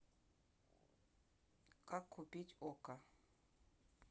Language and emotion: Russian, neutral